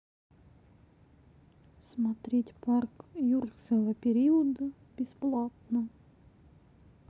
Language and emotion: Russian, sad